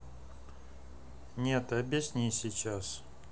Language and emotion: Russian, neutral